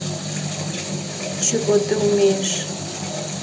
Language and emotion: Russian, neutral